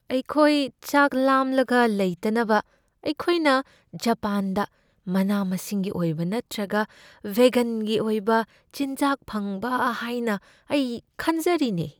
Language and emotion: Manipuri, fearful